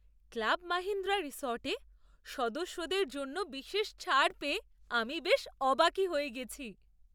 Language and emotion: Bengali, surprised